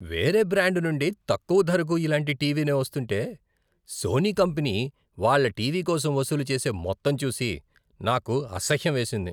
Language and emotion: Telugu, disgusted